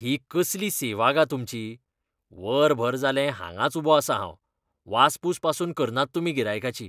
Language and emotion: Goan Konkani, disgusted